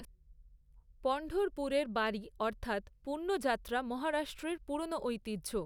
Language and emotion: Bengali, neutral